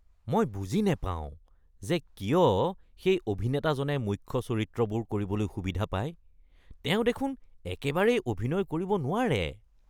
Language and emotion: Assamese, disgusted